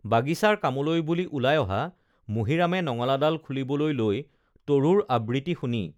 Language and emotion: Assamese, neutral